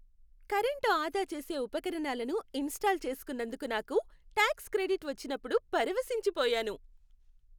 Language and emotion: Telugu, happy